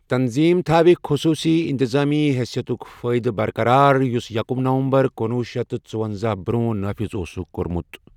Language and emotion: Kashmiri, neutral